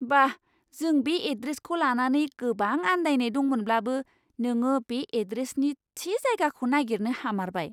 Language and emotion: Bodo, surprised